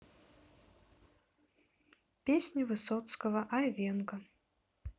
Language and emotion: Russian, neutral